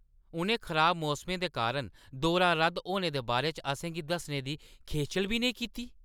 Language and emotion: Dogri, angry